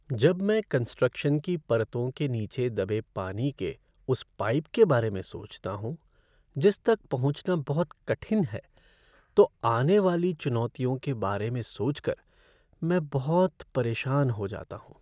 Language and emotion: Hindi, sad